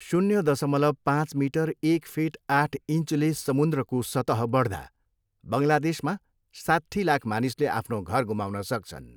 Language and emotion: Nepali, neutral